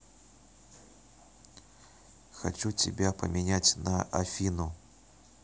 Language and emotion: Russian, neutral